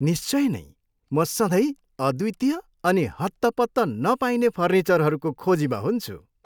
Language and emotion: Nepali, happy